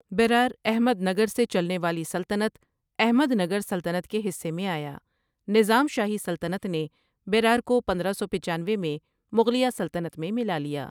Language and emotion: Urdu, neutral